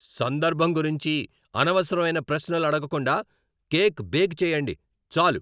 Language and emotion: Telugu, angry